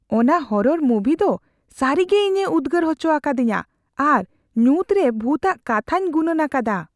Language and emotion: Santali, fearful